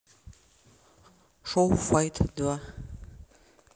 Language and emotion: Russian, neutral